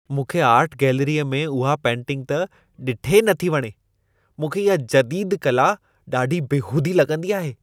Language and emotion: Sindhi, disgusted